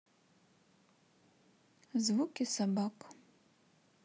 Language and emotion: Russian, neutral